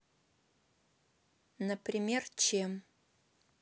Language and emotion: Russian, neutral